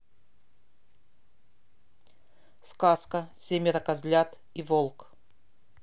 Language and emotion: Russian, neutral